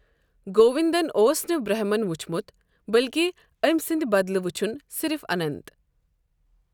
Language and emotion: Kashmiri, neutral